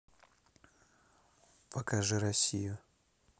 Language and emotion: Russian, neutral